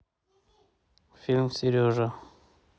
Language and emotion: Russian, neutral